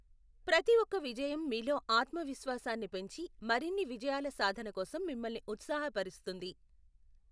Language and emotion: Telugu, neutral